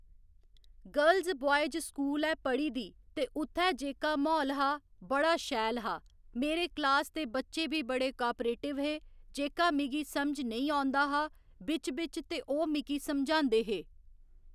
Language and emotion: Dogri, neutral